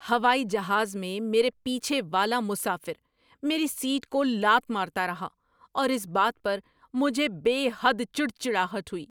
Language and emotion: Urdu, angry